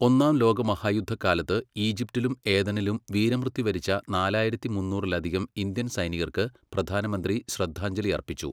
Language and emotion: Malayalam, neutral